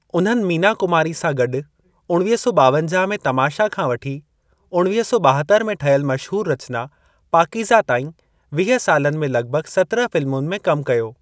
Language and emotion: Sindhi, neutral